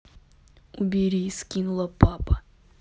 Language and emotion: Russian, neutral